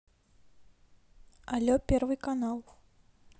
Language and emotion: Russian, neutral